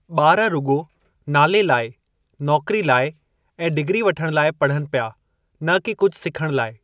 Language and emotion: Sindhi, neutral